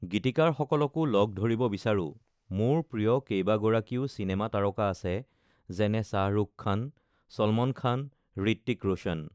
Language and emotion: Assamese, neutral